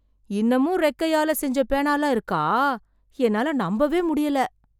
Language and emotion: Tamil, surprised